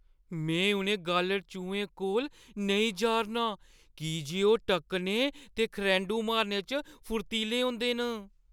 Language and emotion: Dogri, fearful